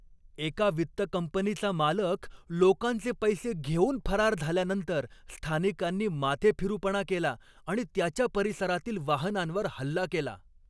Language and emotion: Marathi, angry